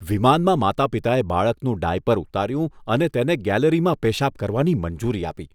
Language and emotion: Gujarati, disgusted